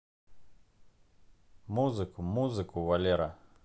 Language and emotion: Russian, neutral